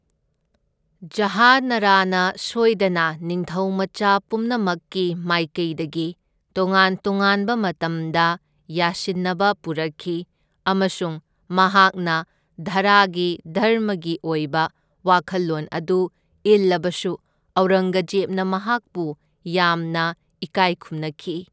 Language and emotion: Manipuri, neutral